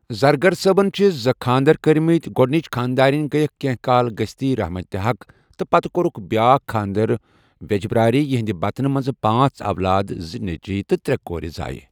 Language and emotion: Kashmiri, neutral